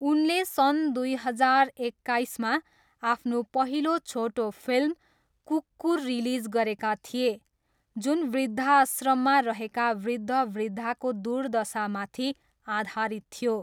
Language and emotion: Nepali, neutral